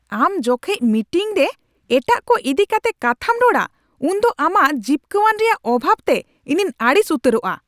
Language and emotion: Santali, angry